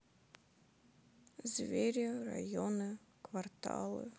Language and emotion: Russian, sad